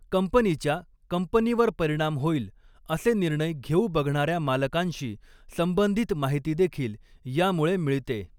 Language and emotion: Marathi, neutral